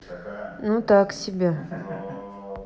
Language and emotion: Russian, neutral